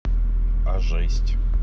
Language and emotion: Russian, neutral